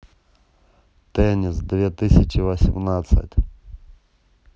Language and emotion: Russian, neutral